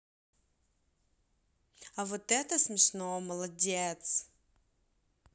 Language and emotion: Russian, positive